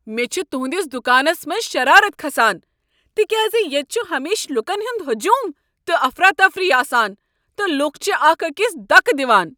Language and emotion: Kashmiri, angry